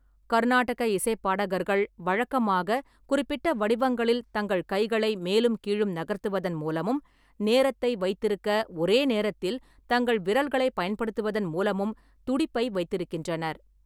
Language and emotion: Tamil, neutral